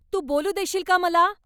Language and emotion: Marathi, angry